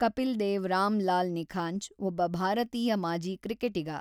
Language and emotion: Kannada, neutral